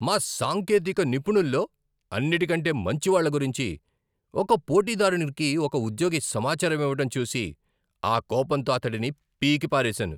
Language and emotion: Telugu, angry